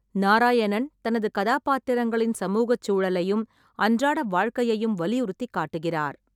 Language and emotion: Tamil, neutral